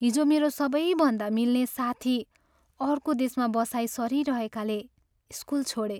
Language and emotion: Nepali, sad